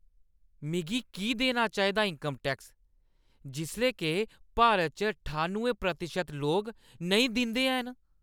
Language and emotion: Dogri, angry